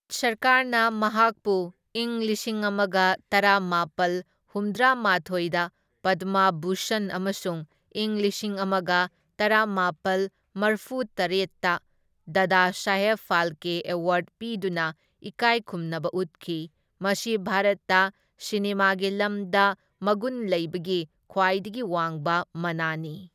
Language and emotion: Manipuri, neutral